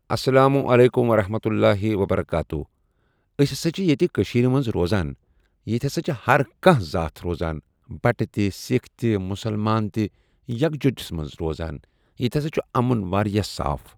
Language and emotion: Kashmiri, neutral